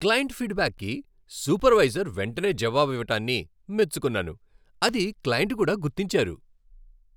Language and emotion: Telugu, happy